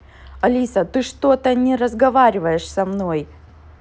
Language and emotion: Russian, angry